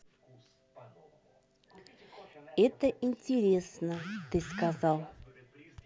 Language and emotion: Russian, neutral